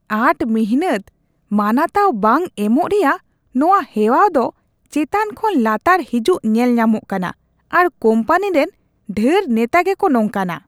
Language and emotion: Santali, disgusted